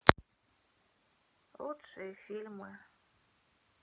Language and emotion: Russian, sad